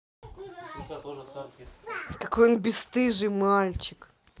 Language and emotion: Russian, angry